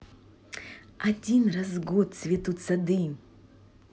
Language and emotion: Russian, positive